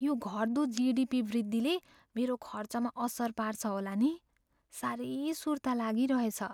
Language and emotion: Nepali, fearful